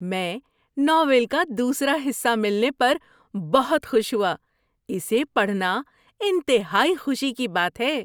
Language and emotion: Urdu, happy